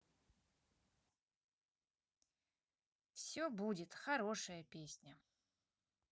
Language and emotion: Russian, neutral